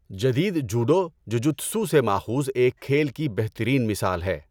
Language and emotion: Urdu, neutral